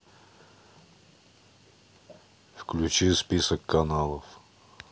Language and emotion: Russian, neutral